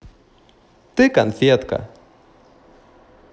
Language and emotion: Russian, positive